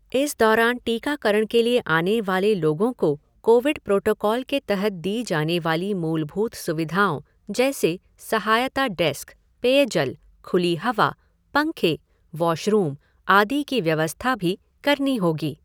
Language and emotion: Hindi, neutral